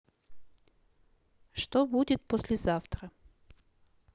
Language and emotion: Russian, neutral